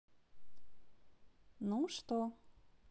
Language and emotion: Russian, positive